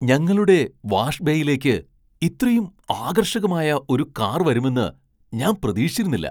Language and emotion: Malayalam, surprised